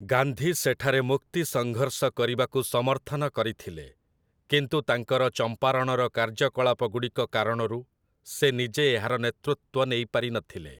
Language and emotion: Odia, neutral